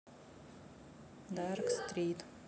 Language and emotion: Russian, neutral